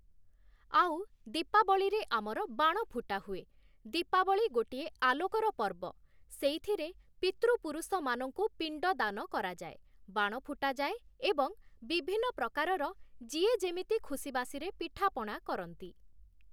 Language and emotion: Odia, neutral